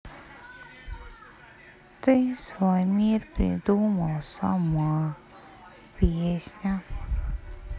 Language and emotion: Russian, sad